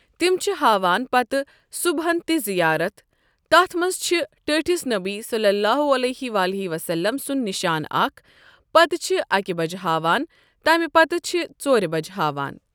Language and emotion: Kashmiri, neutral